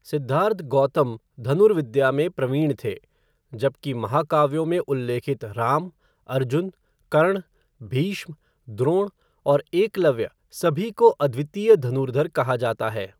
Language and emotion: Hindi, neutral